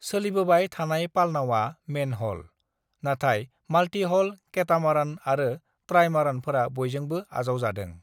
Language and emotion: Bodo, neutral